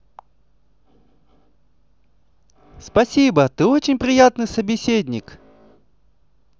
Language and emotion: Russian, positive